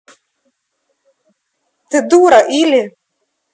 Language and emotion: Russian, angry